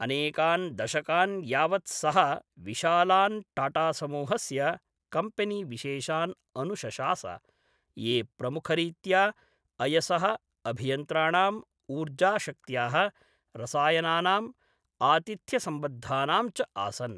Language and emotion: Sanskrit, neutral